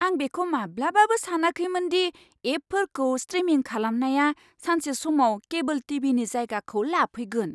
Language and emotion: Bodo, surprised